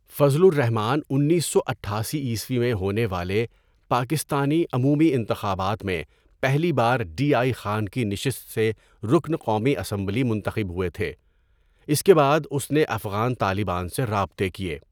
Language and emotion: Urdu, neutral